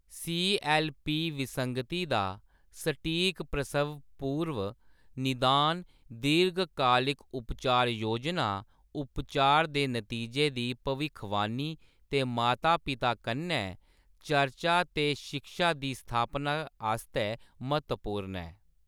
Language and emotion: Dogri, neutral